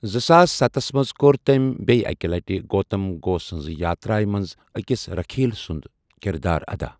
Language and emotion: Kashmiri, neutral